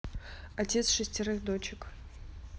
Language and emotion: Russian, neutral